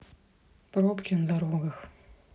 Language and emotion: Russian, sad